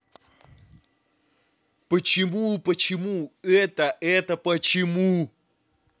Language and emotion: Russian, angry